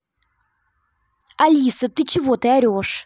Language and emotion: Russian, angry